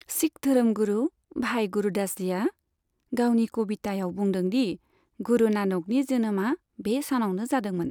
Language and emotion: Bodo, neutral